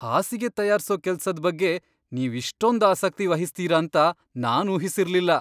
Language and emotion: Kannada, surprised